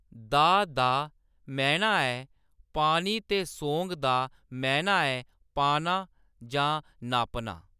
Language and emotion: Dogri, neutral